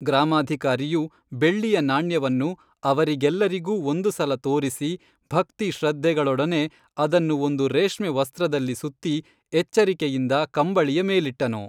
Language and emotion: Kannada, neutral